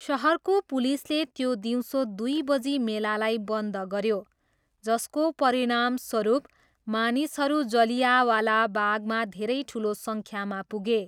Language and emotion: Nepali, neutral